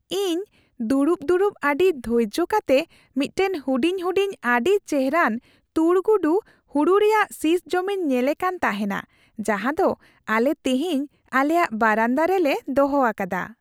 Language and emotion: Santali, happy